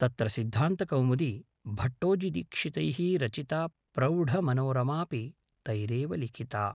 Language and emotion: Sanskrit, neutral